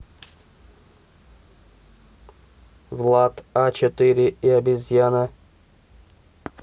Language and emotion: Russian, neutral